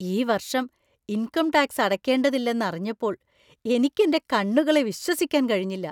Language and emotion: Malayalam, surprised